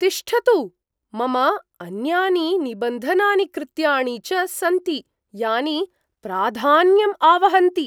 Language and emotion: Sanskrit, surprised